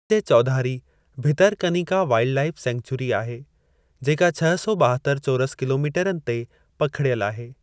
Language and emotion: Sindhi, neutral